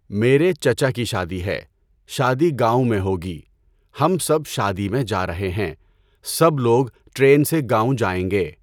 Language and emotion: Urdu, neutral